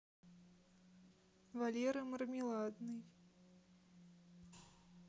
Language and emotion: Russian, neutral